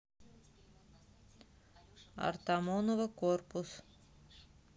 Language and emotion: Russian, neutral